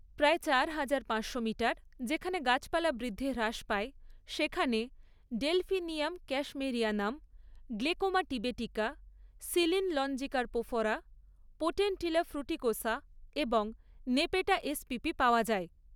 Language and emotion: Bengali, neutral